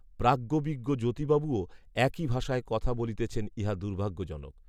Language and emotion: Bengali, neutral